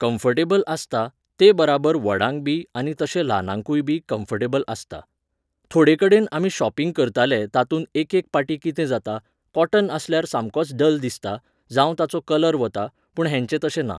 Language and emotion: Goan Konkani, neutral